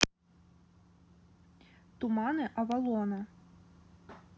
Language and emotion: Russian, neutral